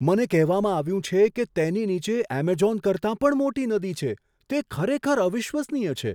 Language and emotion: Gujarati, surprised